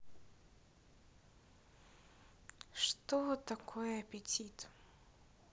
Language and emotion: Russian, neutral